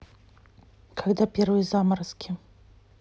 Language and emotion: Russian, neutral